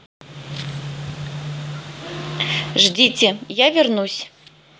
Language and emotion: Russian, neutral